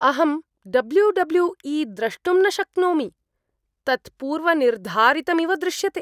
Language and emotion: Sanskrit, disgusted